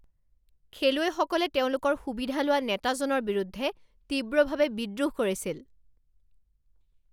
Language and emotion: Assamese, angry